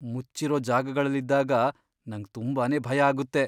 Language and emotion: Kannada, fearful